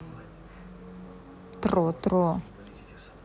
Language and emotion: Russian, neutral